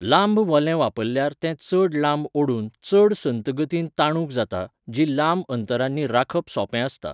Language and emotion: Goan Konkani, neutral